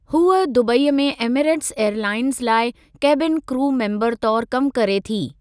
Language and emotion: Sindhi, neutral